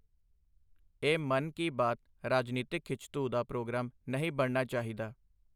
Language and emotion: Punjabi, neutral